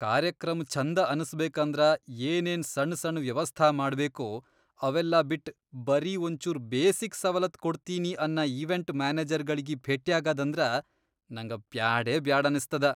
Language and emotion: Kannada, disgusted